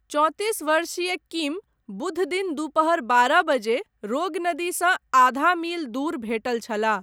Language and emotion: Maithili, neutral